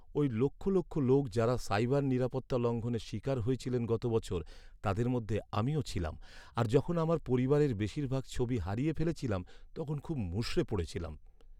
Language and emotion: Bengali, sad